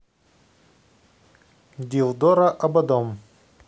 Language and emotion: Russian, neutral